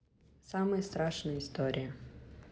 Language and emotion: Russian, neutral